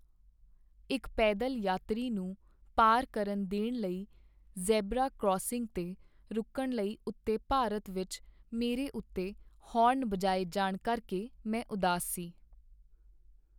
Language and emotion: Punjabi, sad